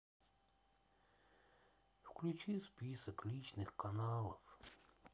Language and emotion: Russian, sad